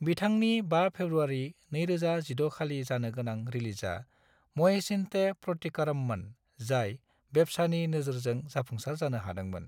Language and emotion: Bodo, neutral